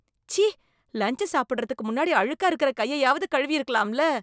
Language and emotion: Tamil, disgusted